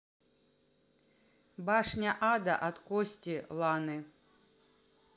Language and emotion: Russian, neutral